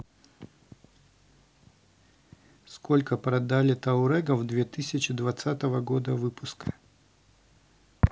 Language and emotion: Russian, neutral